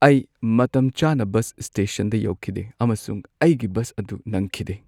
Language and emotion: Manipuri, sad